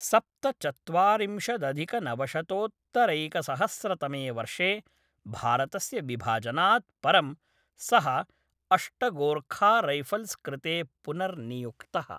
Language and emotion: Sanskrit, neutral